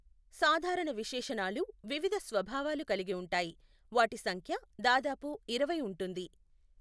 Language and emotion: Telugu, neutral